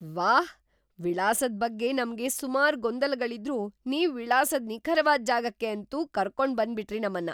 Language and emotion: Kannada, surprised